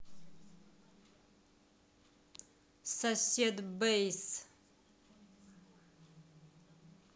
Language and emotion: Russian, angry